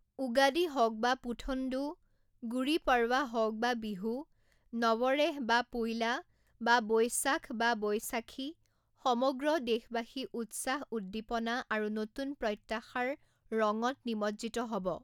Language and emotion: Assamese, neutral